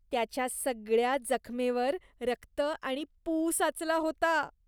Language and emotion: Marathi, disgusted